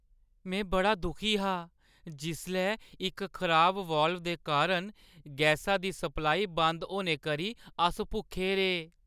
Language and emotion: Dogri, sad